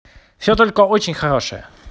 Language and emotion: Russian, positive